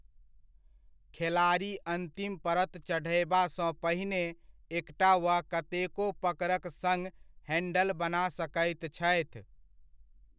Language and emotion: Maithili, neutral